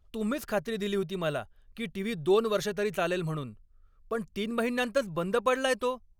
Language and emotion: Marathi, angry